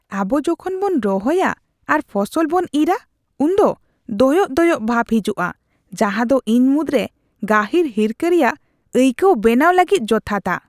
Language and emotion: Santali, disgusted